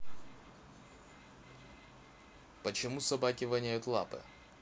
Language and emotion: Russian, neutral